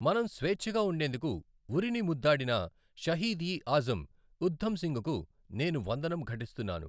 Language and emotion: Telugu, neutral